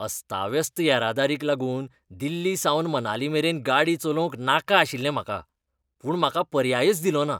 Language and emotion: Goan Konkani, disgusted